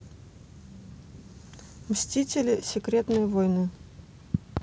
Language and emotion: Russian, neutral